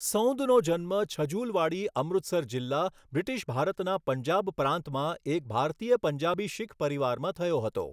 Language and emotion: Gujarati, neutral